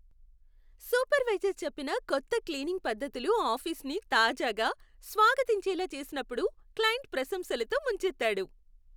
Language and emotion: Telugu, happy